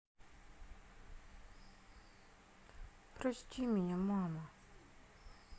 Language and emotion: Russian, sad